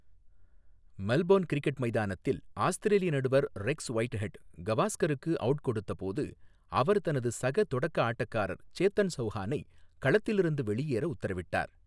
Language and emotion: Tamil, neutral